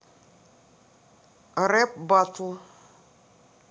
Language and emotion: Russian, neutral